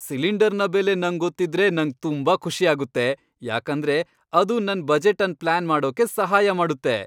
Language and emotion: Kannada, happy